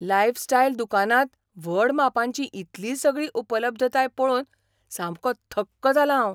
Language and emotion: Goan Konkani, surprised